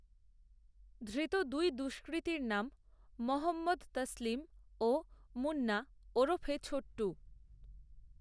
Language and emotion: Bengali, neutral